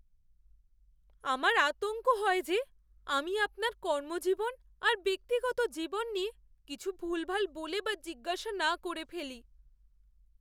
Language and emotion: Bengali, fearful